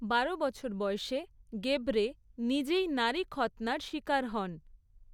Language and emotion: Bengali, neutral